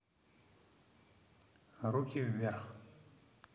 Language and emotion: Russian, neutral